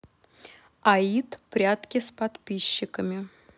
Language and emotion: Russian, neutral